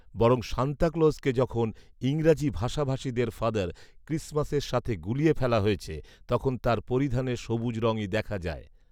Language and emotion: Bengali, neutral